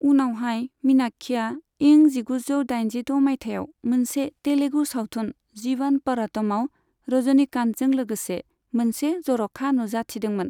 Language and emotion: Bodo, neutral